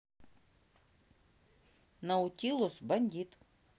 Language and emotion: Russian, neutral